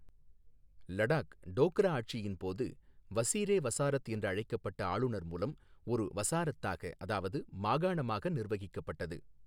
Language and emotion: Tamil, neutral